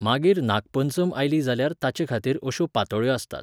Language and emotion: Goan Konkani, neutral